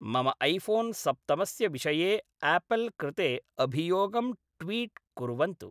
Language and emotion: Sanskrit, neutral